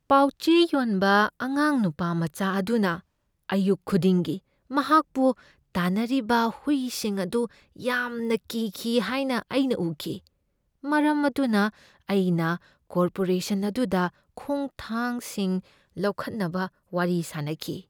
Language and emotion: Manipuri, fearful